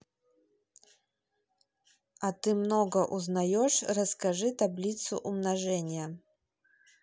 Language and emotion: Russian, neutral